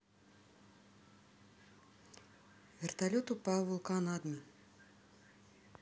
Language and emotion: Russian, neutral